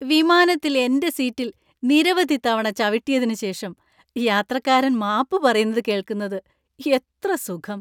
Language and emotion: Malayalam, happy